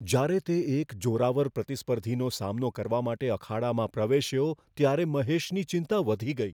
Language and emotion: Gujarati, fearful